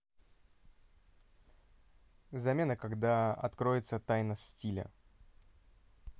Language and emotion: Russian, neutral